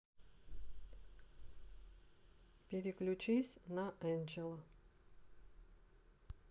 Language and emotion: Russian, neutral